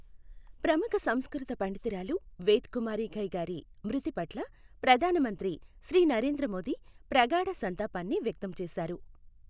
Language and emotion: Telugu, neutral